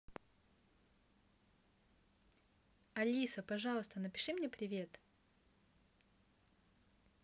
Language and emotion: Russian, positive